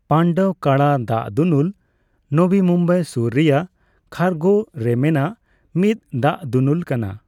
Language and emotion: Santali, neutral